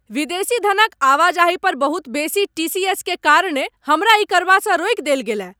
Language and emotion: Maithili, angry